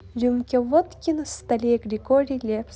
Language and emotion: Russian, positive